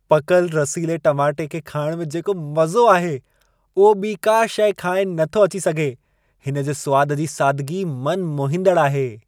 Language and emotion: Sindhi, happy